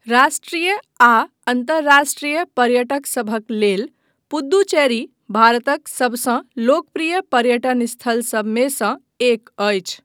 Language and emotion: Maithili, neutral